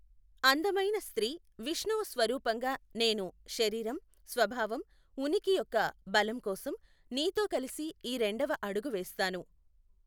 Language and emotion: Telugu, neutral